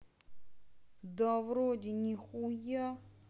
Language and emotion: Russian, neutral